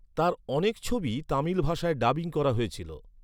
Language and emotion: Bengali, neutral